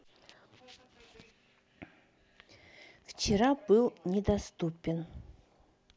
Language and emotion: Russian, neutral